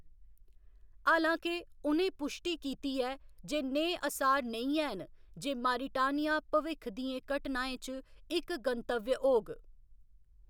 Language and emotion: Dogri, neutral